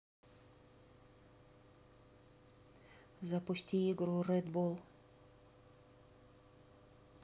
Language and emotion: Russian, neutral